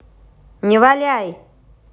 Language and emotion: Russian, angry